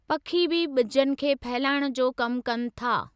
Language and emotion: Sindhi, neutral